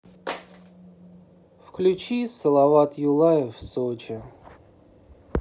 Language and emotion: Russian, sad